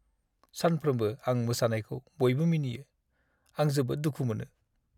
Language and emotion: Bodo, sad